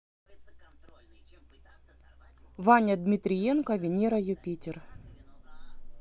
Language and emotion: Russian, neutral